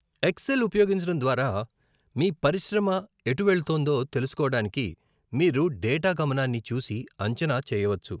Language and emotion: Telugu, neutral